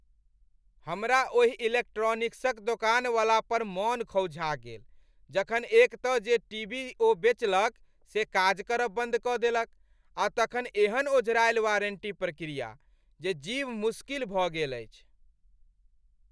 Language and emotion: Maithili, angry